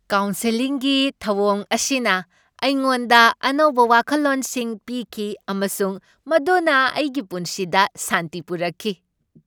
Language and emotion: Manipuri, happy